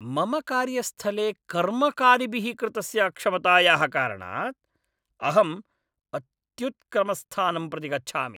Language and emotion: Sanskrit, angry